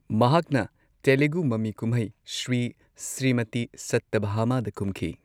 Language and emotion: Manipuri, neutral